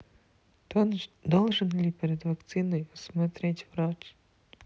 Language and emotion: Russian, sad